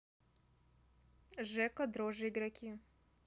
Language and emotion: Russian, neutral